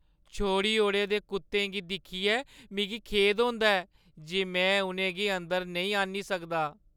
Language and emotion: Dogri, sad